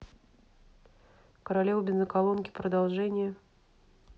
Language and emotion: Russian, neutral